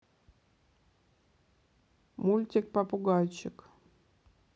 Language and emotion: Russian, positive